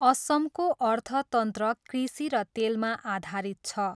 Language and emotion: Nepali, neutral